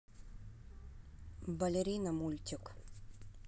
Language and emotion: Russian, neutral